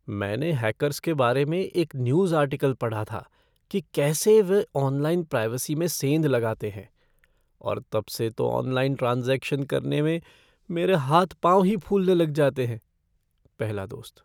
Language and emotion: Hindi, fearful